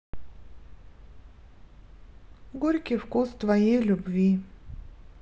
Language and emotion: Russian, sad